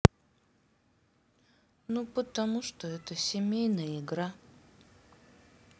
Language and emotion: Russian, sad